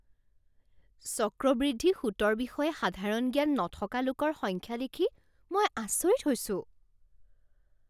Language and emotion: Assamese, surprised